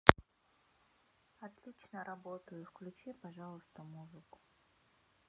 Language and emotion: Russian, neutral